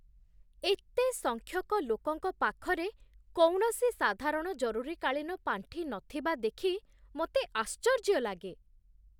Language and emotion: Odia, surprised